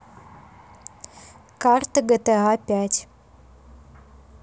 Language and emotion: Russian, neutral